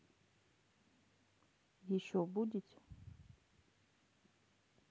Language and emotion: Russian, neutral